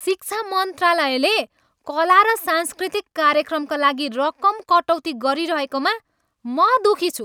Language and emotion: Nepali, angry